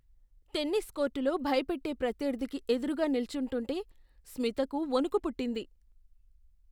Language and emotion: Telugu, fearful